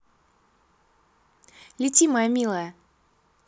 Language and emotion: Russian, positive